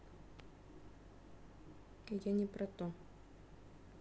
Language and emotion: Russian, neutral